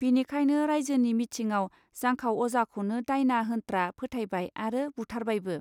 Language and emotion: Bodo, neutral